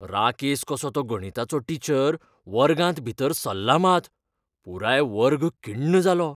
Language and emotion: Goan Konkani, fearful